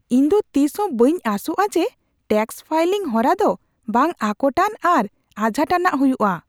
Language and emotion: Santali, surprised